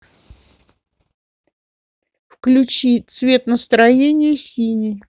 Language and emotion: Russian, neutral